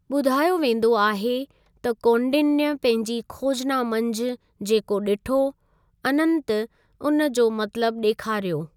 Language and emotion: Sindhi, neutral